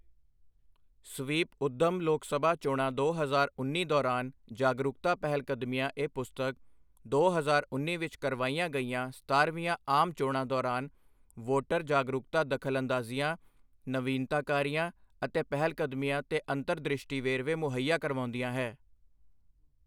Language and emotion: Punjabi, neutral